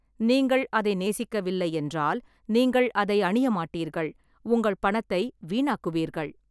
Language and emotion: Tamil, neutral